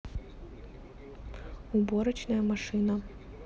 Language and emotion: Russian, neutral